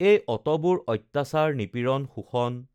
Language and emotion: Assamese, neutral